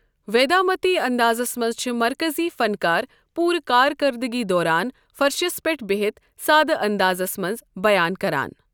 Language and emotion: Kashmiri, neutral